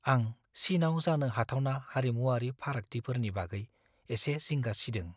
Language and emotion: Bodo, fearful